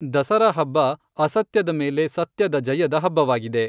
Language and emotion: Kannada, neutral